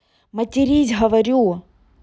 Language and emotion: Russian, neutral